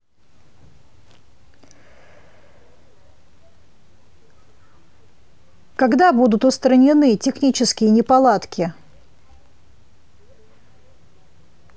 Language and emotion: Russian, neutral